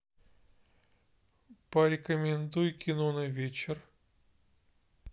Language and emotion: Russian, neutral